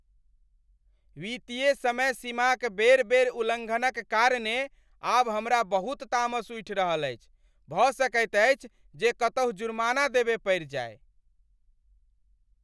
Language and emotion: Maithili, angry